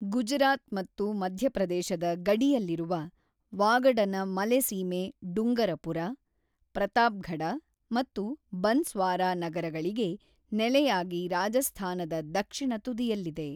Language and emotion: Kannada, neutral